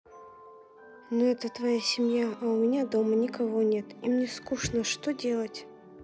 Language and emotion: Russian, sad